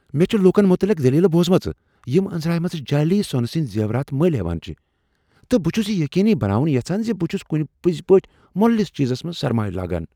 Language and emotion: Kashmiri, fearful